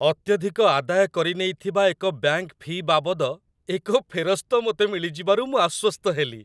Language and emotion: Odia, happy